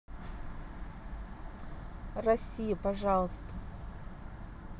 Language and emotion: Russian, neutral